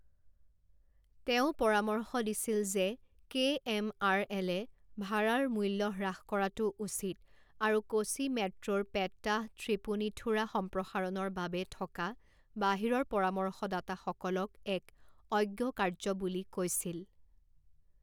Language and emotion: Assamese, neutral